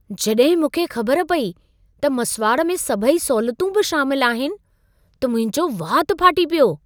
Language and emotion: Sindhi, surprised